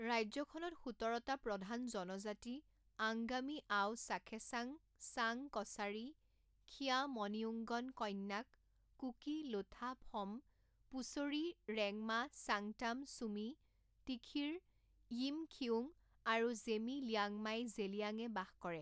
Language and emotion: Assamese, neutral